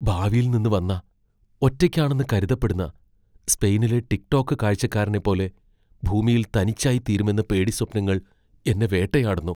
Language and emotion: Malayalam, fearful